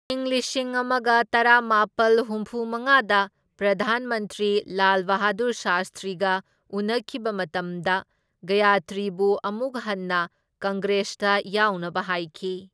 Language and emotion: Manipuri, neutral